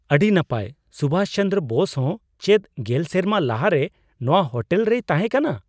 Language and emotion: Santali, surprised